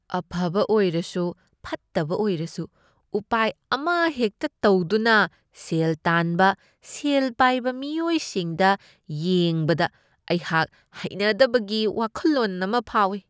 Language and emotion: Manipuri, disgusted